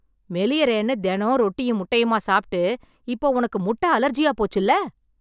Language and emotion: Tamil, angry